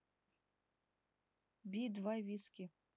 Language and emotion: Russian, neutral